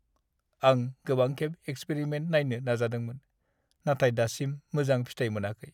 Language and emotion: Bodo, sad